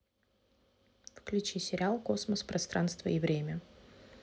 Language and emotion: Russian, neutral